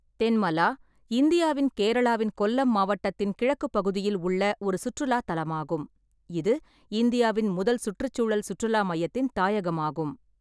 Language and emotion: Tamil, neutral